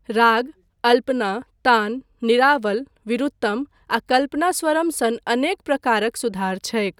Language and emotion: Maithili, neutral